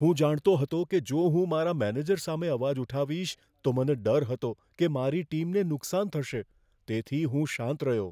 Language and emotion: Gujarati, fearful